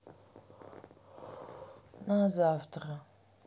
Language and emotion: Russian, neutral